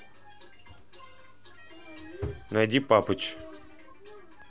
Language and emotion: Russian, neutral